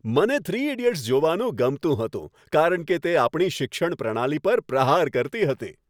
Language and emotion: Gujarati, happy